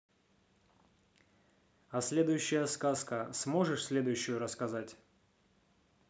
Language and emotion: Russian, neutral